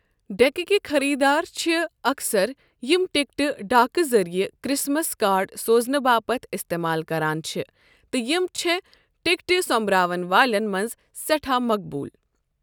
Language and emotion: Kashmiri, neutral